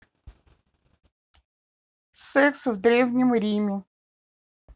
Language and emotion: Russian, neutral